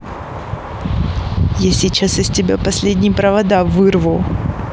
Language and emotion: Russian, angry